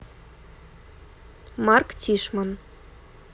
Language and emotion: Russian, neutral